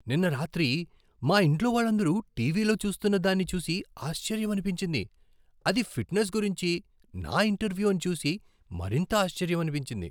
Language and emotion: Telugu, surprised